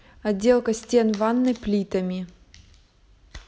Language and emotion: Russian, neutral